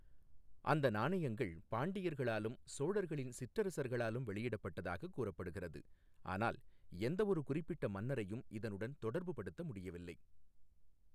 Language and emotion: Tamil, neutral